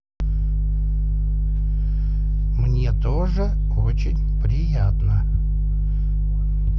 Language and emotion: Russian, neutral